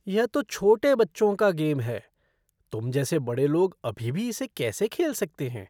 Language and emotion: Hindi, disgusted